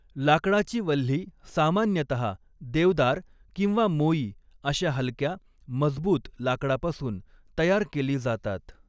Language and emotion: Marathi, neutral